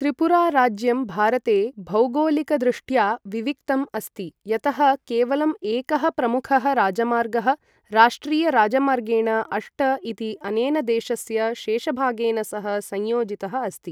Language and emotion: Sanskrit, neutral